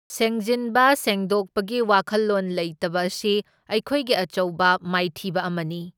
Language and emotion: Manipuri, neutral